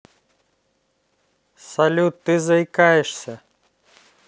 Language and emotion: Russian, neutral